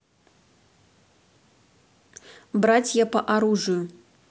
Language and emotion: Russian, neutral